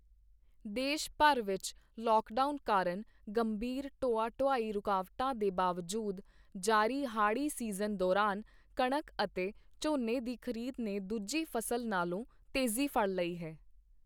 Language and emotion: Punjabi, neutral